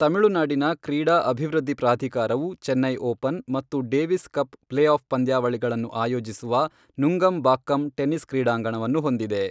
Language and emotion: Kannada, neutral